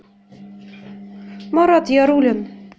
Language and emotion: Russian, neutral